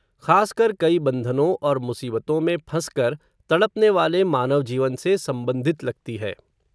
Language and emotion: Hindi, neutral